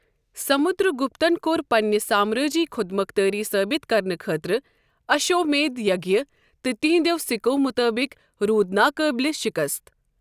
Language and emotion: Kashmiri, neutral